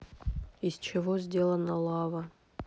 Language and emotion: Russian, neutral